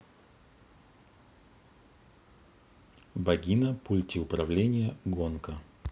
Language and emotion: Russian, neutral